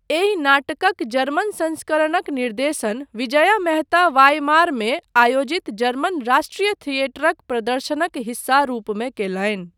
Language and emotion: Maithili, neutral